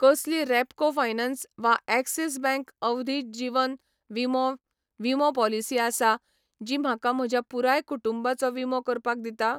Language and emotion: Goan Konkani, neutral